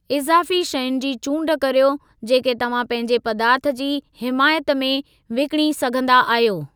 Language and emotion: Sindhi, neutral